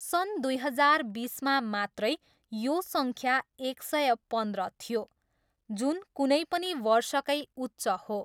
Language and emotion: Nepali, neutral